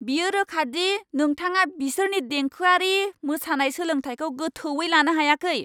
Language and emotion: Bodo, angry